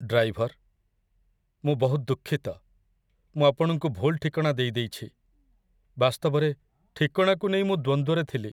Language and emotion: Odia, sad